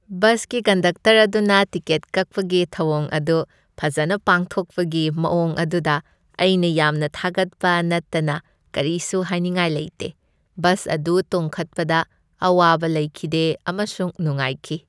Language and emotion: Manipuri, happy